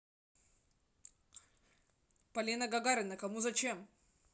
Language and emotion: Russian, neutral